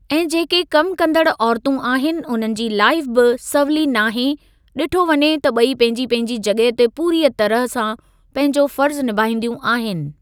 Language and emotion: Sindhi, neutral